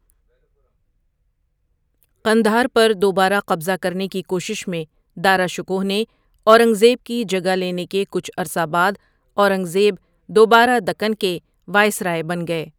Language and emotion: Urdu, neutral